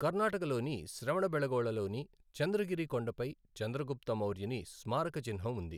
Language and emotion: Telugu, neutral